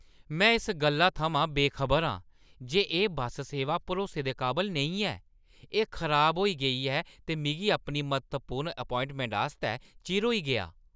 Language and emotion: Dogri, angry